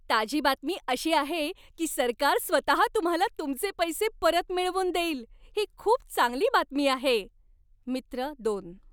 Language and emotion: Marathi, happy